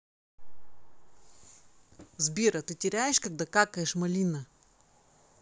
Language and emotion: Russian, neutral